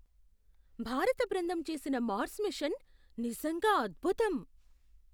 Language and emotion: Telugu, surprised